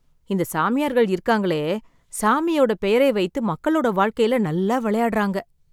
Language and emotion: Tamil, sad